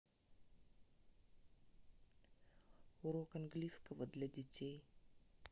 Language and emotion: Russian, neutral